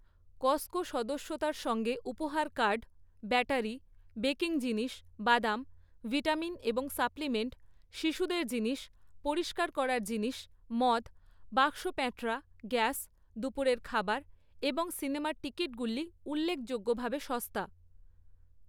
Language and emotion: Bengali, neutral